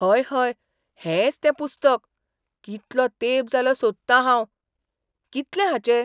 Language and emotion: Goan Konkani, surprised